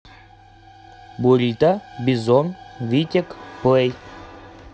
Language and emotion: Russian, neutral